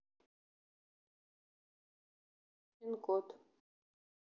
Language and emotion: Russian, neutral